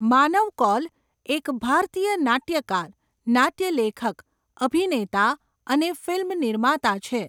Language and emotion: Gujarati, neutral